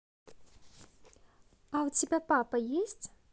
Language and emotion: Russian, neutral